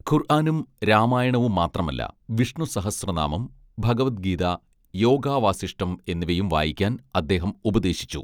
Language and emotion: Malayalam, neutral